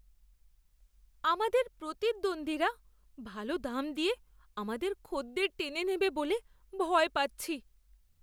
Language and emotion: Bengali, fearful